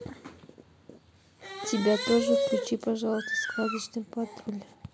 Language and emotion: Russian, neutral